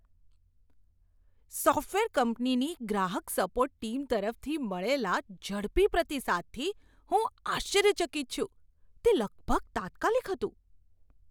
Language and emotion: Gujarati, surprised